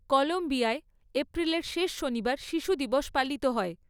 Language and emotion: Bengali, neutral